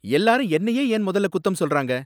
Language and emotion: Tamil, angry